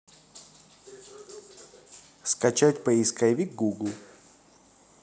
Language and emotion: Russian, neutral